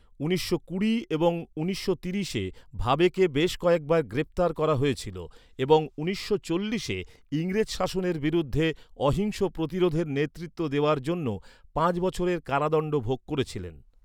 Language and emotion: Bengali, neutral